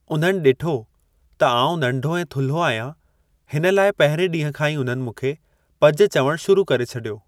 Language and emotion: Sindhi, neutral